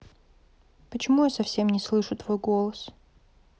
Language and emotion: Russian, sad